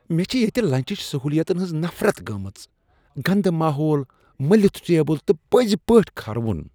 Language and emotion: Kashmiri, disgusted